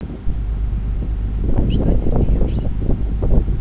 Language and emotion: Russian, neutral